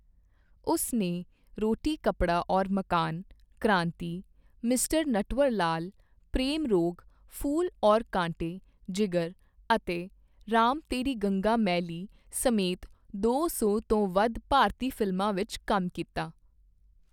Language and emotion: Punjabi, neutral